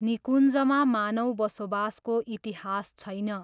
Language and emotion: Nepali, neutral